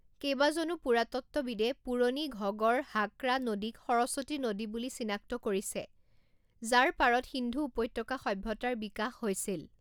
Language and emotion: Assamese, neutral